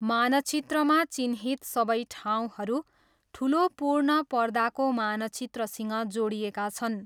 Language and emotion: Nepali, neutral